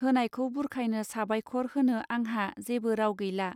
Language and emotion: Bodo, neutral